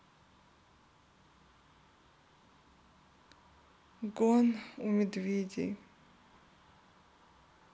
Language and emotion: Russian, sad